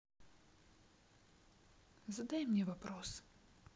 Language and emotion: Russian, sad